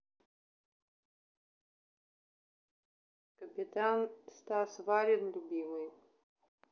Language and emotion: Russian, neutral